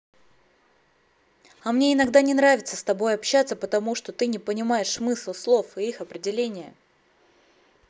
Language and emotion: Russian, angry